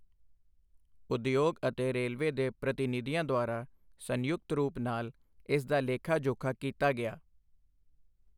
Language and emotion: Punjabi, neutral